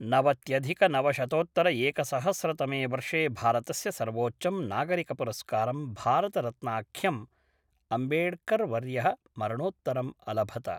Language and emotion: Sanskrit, neutral